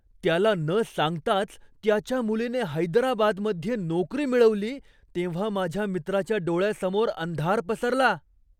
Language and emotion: Marathi, surprised